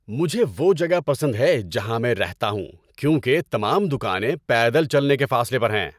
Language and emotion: Urdu, happy